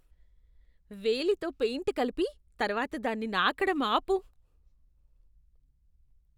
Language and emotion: Telugu, disgusted